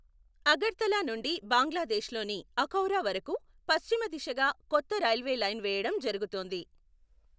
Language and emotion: Telugu, neutral